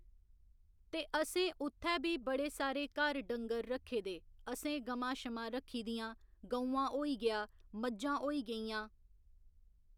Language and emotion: Dogri, neutral